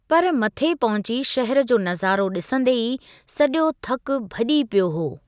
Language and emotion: Sindhi, neutral